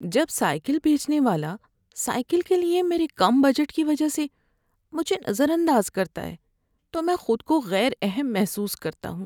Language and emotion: Urdu, sad